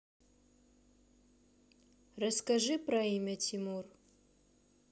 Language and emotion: Russian, neutral